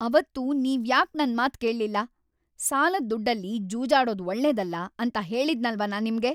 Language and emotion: Kannada, angry